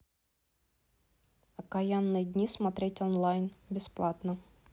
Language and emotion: Russian, neutral